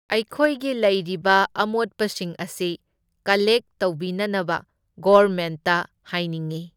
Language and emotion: Manipuri, neutral